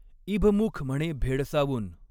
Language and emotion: Marathi, neutral